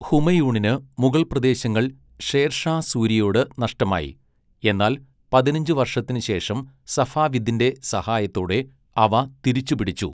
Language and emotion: Malayalam, neutral